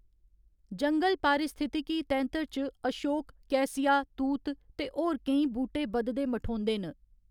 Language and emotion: Dogri, neutral